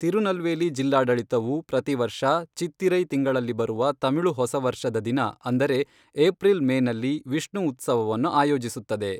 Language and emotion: Kannada, neutral